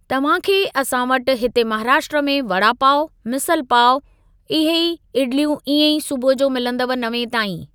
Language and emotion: Sindhi, neutral